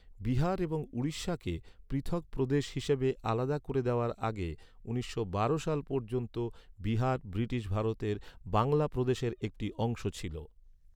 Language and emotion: Bengali, neutral